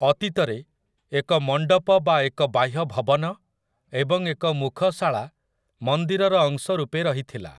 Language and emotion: Odia, neutral